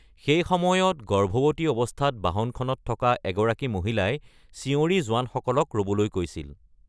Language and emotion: Assamese, neutral